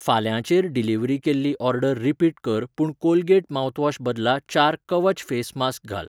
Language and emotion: Goan Konkani, neutral